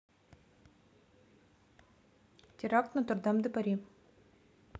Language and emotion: Russian, neutral